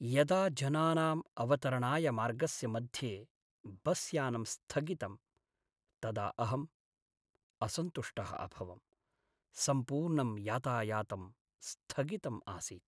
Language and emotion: Sanskrit, sad